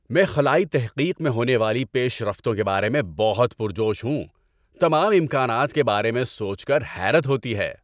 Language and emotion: Urdu, happy